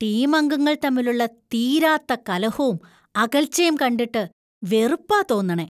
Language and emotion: Malayalam, disgusted